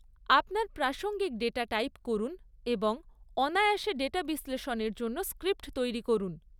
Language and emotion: Bengali, neutral